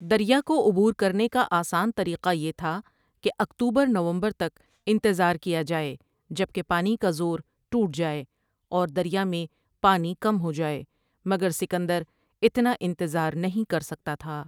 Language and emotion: Urdu, neutral